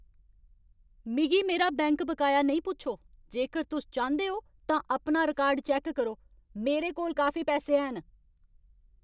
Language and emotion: Dogri, angry